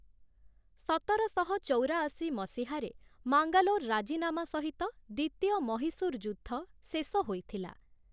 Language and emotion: Odia, neutral